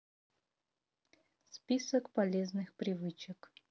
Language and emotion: Russian, neutral